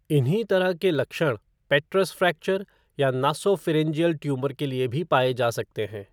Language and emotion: Hindi, neutral